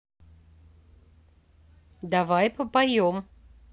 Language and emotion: Russian, neutral